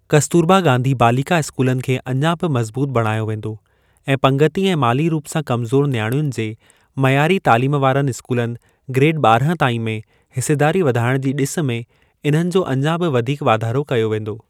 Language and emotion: Sindhi, neutral